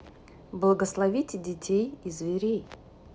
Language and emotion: Russian, neutral